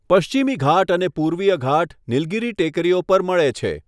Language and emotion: Gujarati, neutral